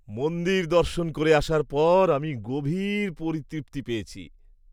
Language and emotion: Bengali, happy